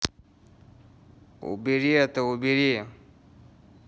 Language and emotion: Russian, angry